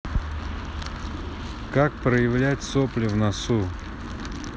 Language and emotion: Russian, neutral